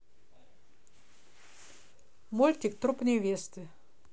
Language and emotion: Russian, neutral